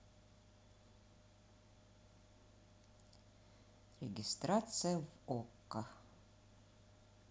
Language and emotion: Russian, neutral